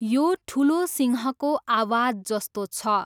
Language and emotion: Nepali, neutral